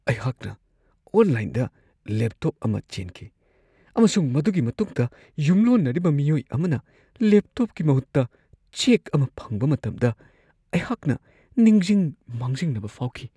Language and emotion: Manipuri, fearful